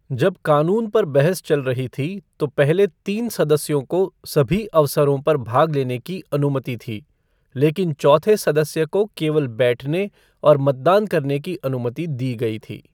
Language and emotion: Hindi, neutral